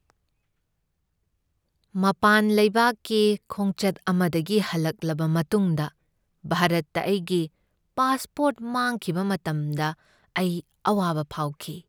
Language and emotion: Manipuri, sad